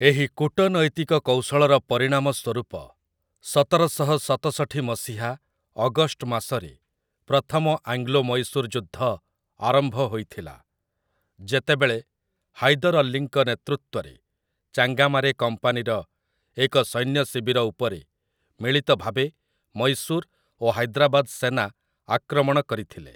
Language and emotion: Odia, neutral